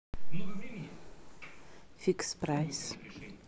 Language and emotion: Russian, neutral